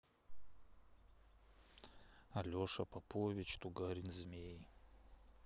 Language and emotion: Russian, neutral